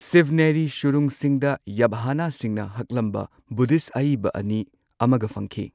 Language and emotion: Manipuri, neutral